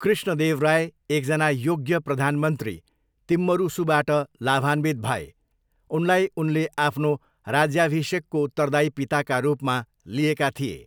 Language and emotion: Nepali, neutral